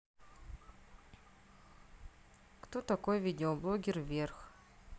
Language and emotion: Russian, neutral